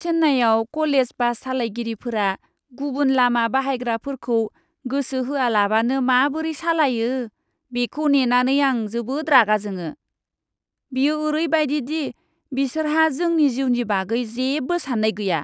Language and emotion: Bodo, disgusted